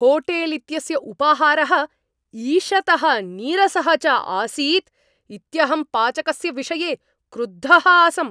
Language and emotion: Sanskrit, angry